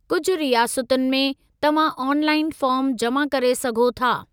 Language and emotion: Sindhi, neutral